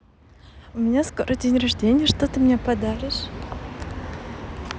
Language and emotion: Russian, positive